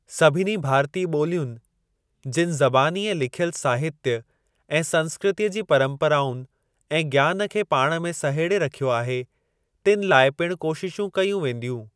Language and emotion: Sindhi, neutral